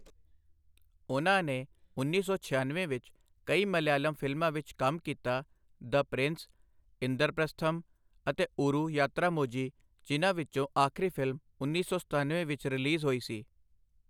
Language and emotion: Punjabi, neutral